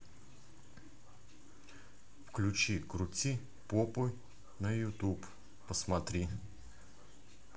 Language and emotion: Russian, neutral